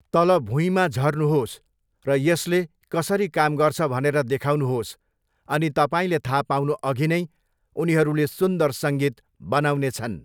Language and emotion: Nepali, neutral